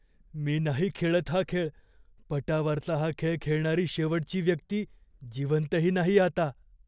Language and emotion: Marathi, fearful